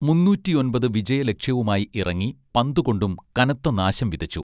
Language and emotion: Malayalam, neutral